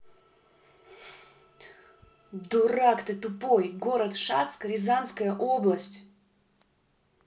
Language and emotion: Russian, angry